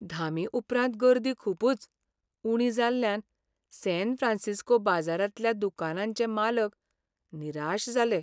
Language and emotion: Goan Konkani, sad